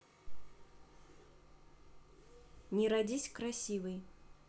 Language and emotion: Russian, neutral